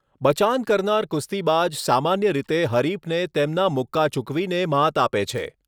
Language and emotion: Gujarati, neutral